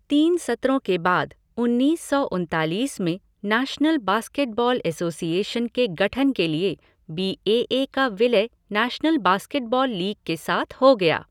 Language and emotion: Hindi, neutral